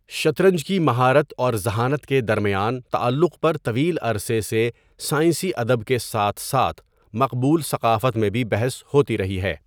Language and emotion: Urdu, neutral